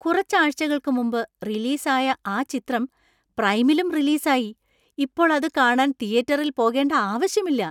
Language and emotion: Malayalam, surprised